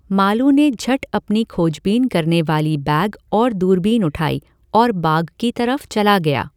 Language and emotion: Hindi, neutral